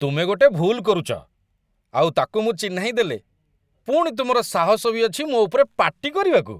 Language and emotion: Odia, disgusted